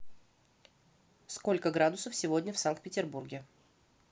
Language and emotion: Russian, neutral